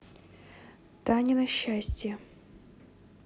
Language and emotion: Russian, neutral